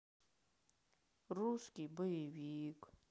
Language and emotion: Russian, sad